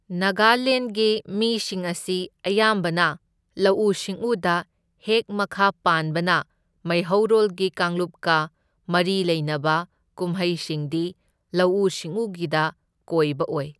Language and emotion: Manipuri, neutral